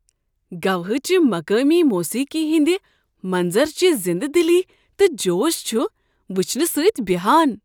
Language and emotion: Kashmiri, surprised